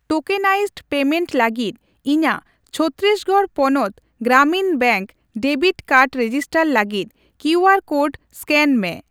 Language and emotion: Santali, neutral